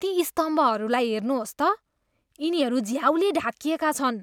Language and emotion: Nepali, disgusted